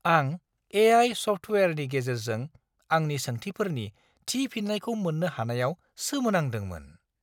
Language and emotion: Bodo, surprised